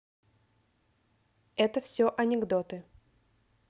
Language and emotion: Russian, neutral